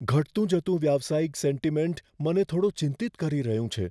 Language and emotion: Gujarati, fearful